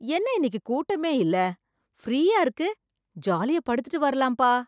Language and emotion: Tamil, surprised